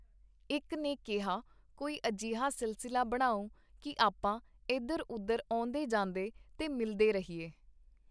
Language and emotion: Punjabi, neutral